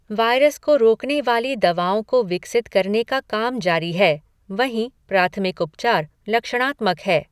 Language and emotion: Hindi, neutral